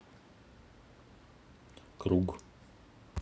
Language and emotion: Russian, neutral